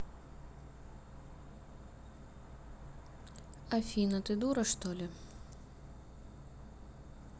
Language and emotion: Russian, neutral